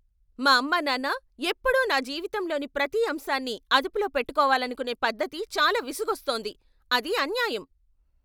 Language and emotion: Telugu, angry